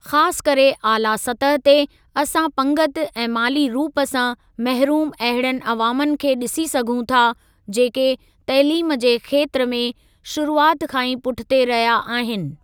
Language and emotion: Sindhi, neutral